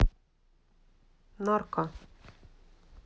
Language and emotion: Russian, neutral